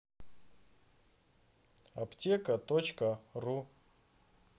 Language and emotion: Russian, neutral